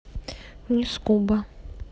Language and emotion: Russian, neutral